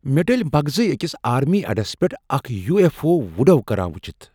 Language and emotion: Kashmiri, surprised